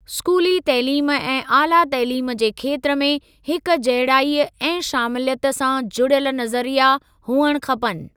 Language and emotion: Sindhi, neutral